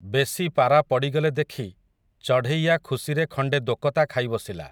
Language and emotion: Odia, neutral